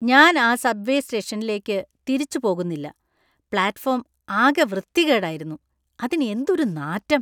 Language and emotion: Malayalam, disgusted